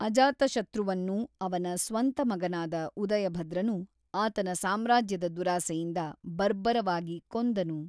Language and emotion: Kannada, neutral